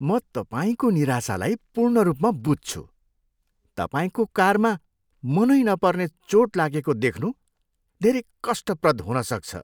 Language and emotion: Nepali, disgusted